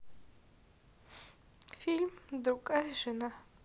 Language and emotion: Russian, sad